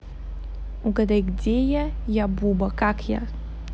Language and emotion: Russian, neutral